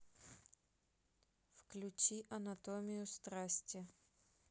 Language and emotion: Russian, neutral